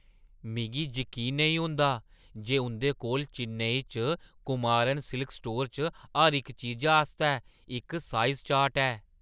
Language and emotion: Dogri, surprised